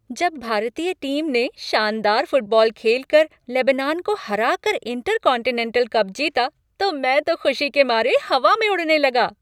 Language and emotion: Hindi, happy